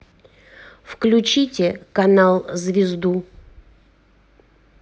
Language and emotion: Russian, neutral